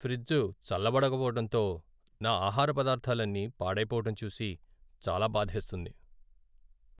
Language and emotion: Telugu, sad